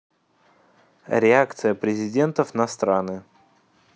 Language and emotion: Russian, neutral